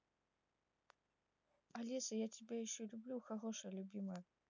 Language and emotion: Russian, neutral